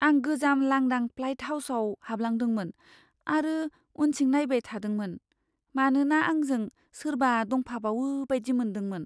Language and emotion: Bodo, fearful